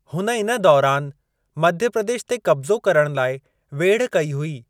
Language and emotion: Sindhi, neutral